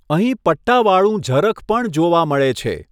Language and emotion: Gujarati, neutral